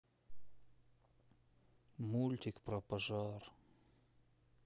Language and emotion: Russian, sad